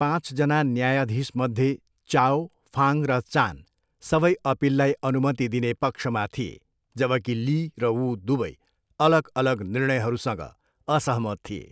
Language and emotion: Nepali, neutral